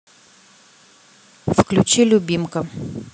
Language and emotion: Russian, neutral